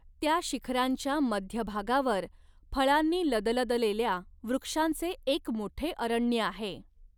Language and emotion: Marathi, neutral